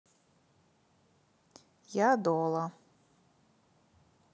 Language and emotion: Russian, neutral